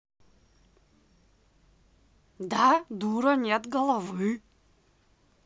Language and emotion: Russian, angry